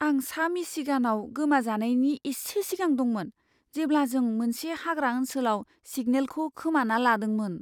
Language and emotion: Bodo, fearful